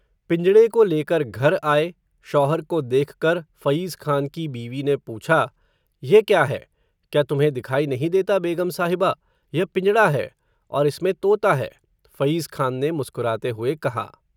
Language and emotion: Hindi, neutral